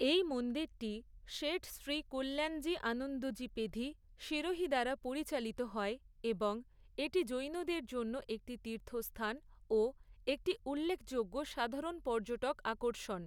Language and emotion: Bengali, neutral